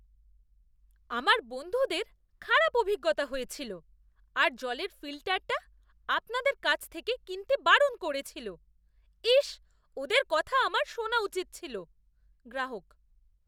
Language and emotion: Bengali, disgusted